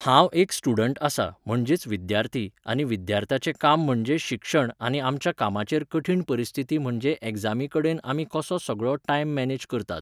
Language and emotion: Goan Konkani, neutral